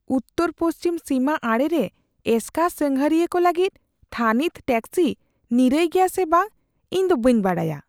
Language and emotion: Santali, fearful